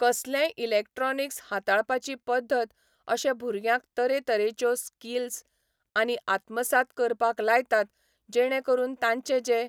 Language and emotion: Goan Konkani, neutral